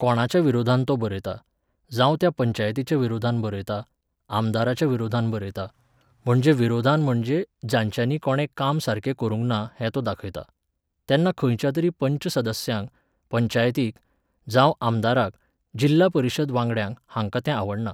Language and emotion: Goan Konkani, neutral